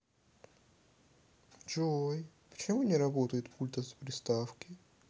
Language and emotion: Russian, sad